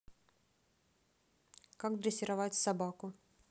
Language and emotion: Russian, neutral